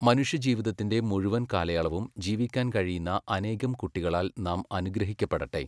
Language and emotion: Malayalam, neutral